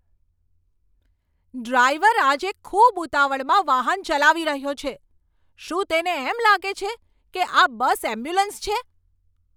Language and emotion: Gujarati, angry